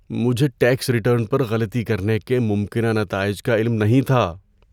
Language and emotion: Urdu, fearful